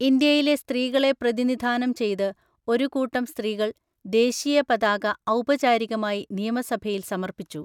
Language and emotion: Malayalam, neutral